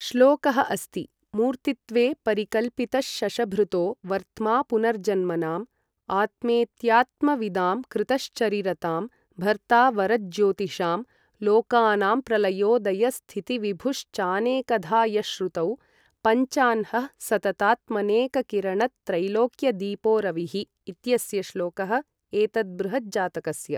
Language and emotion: Sanskrit, neutral